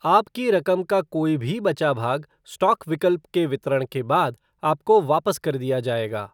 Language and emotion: Hindi, neutral